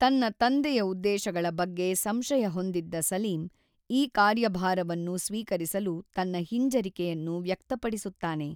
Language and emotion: Kannada, neutral